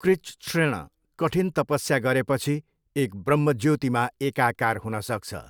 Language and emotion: Nepali, neutral